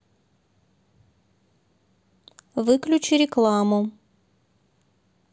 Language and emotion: Russian, neutral